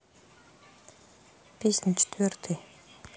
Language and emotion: Russian, sad